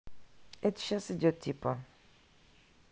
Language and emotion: Russian, neutral